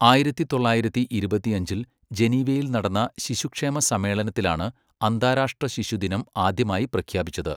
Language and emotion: Malayalam, neutral